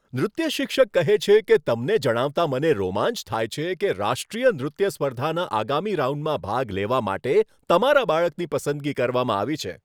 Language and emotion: Gujarati, happy